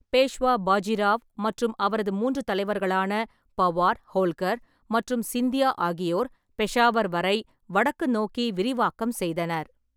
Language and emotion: Tamil, neutral